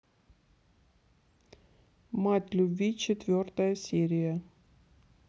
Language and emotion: Russian, neutral